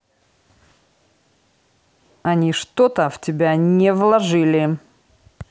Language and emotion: Russian, angry